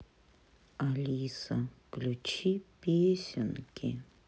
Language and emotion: Russian, sad